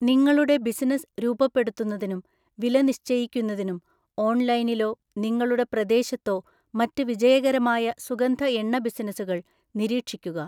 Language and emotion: Malayalam, neutral